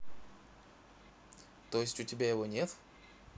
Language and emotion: Russian, neutral